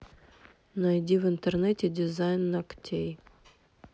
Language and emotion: Russian, neutral